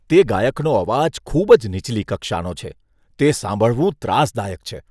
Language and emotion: Gujarati, disgusted